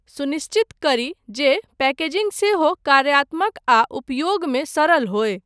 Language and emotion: Maithili, neutral